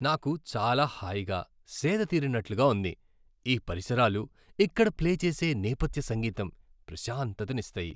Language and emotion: Telugu, happy